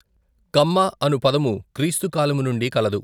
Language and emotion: Telugu, neutral